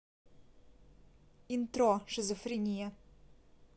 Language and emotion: Russian, neutral